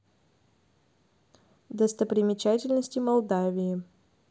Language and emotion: Russian, neutral